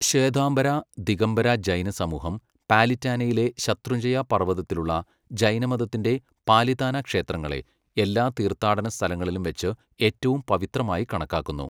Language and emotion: Malayalam, neutral